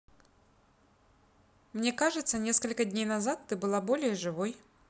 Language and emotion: Russian, neutral